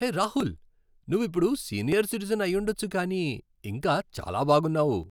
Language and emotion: Telugu, happy